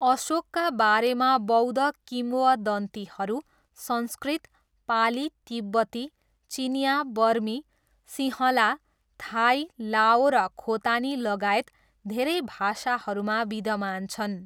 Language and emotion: Nepali, neutral